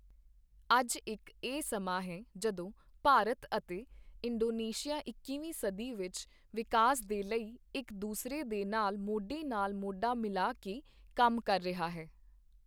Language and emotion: Punjabi, neutral